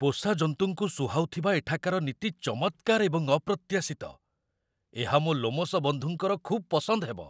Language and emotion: Odia, surprised